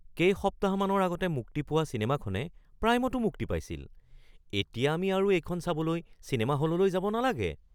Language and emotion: Assamese, surprised